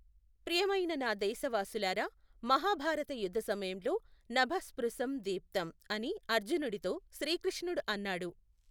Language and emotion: Telugu, neutral